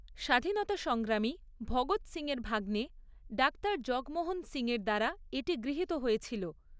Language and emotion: Bengali, neutral